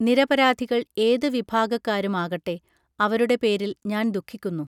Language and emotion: Malayalam, neutral